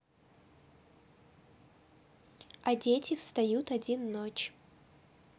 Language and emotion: Russian, neutral